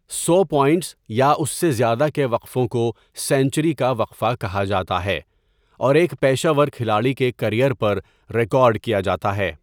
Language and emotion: Urdu, neutral